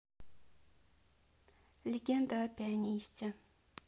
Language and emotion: Russian, neutral